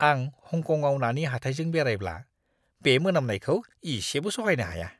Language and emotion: Bodo, disgusted